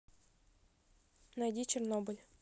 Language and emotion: Russian, neutral